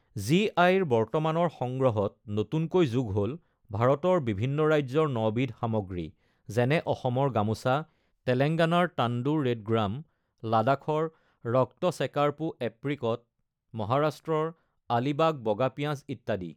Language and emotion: Assamese, neutral